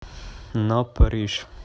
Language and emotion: Russian, neutral